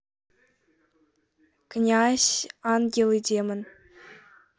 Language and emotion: Russian, neutral